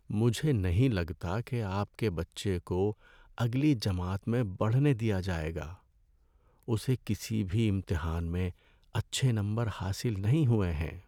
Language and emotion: Urdu, sad